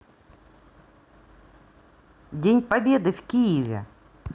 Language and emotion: Russian, positive